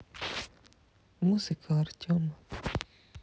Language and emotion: Russian, sad